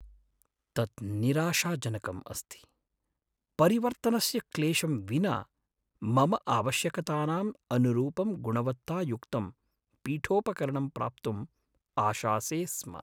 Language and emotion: Sanskrit, sad